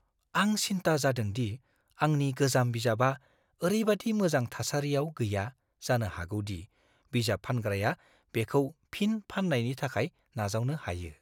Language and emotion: Bodo, fearful